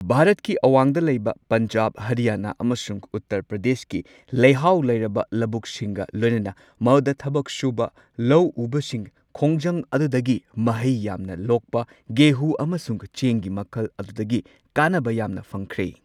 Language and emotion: Manipuri, neutral